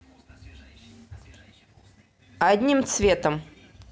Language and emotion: Russian, neutral